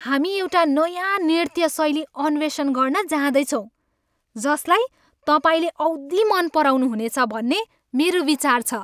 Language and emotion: Nepali, happy